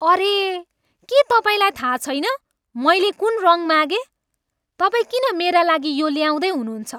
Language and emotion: Nepali, angry